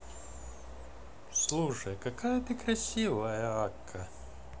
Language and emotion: Russian, positive